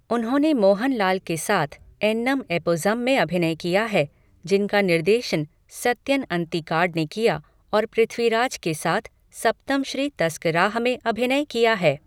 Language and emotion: Hindi, neutral